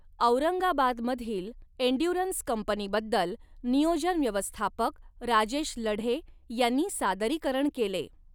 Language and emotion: Marathi, neutral